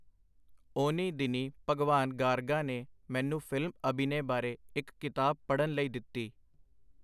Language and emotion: Punjabi, neutral